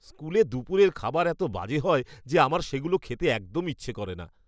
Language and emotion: Bengali, disgusted